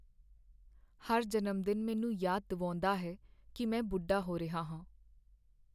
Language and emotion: Punjabi, sad